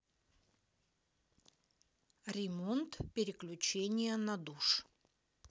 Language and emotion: Russian, neutral